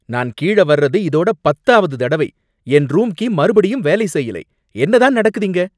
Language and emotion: Tamil, angry